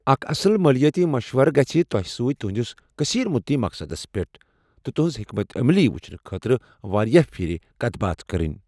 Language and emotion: Kashmiri, neutral